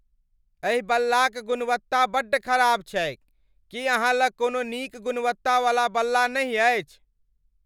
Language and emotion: Maithili, angry